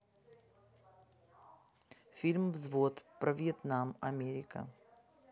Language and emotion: Russian, neutral